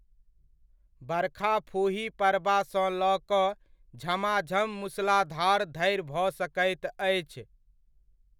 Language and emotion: Maithili, neutral